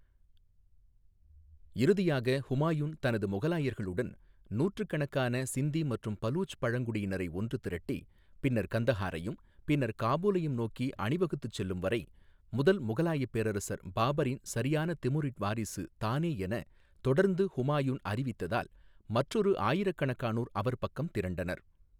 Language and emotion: Tamil, neutral